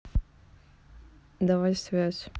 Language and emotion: Russian, neutral